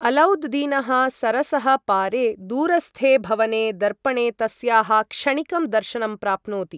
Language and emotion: Sanskrit, neutral